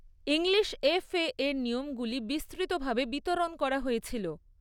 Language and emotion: Bengali, neutral